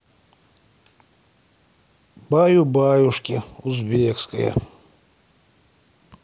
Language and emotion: Russian, sad